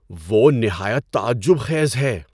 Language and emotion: Urdu, surprised